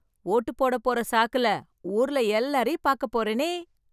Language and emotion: Tamil, happy